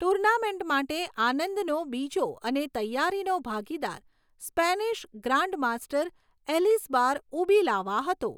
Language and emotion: Gujarati, neutral